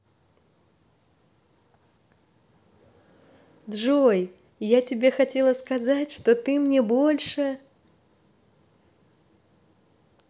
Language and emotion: Russian, positive